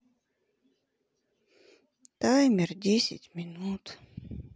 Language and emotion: Russian, sad